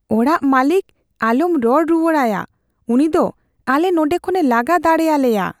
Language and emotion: Santali, fearful